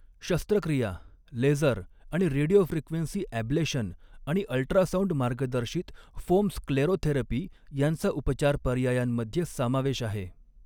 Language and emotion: Marathi, neutral